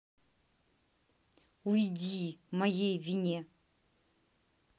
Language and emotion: Russian, angry